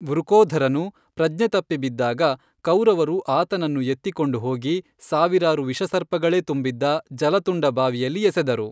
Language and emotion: Kannada, neutral